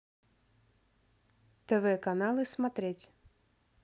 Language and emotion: Russian, neutral